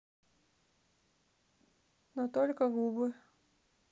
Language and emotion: Russian, sad